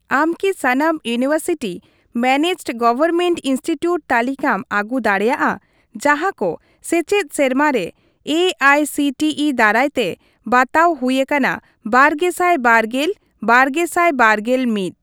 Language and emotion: Santali, neutral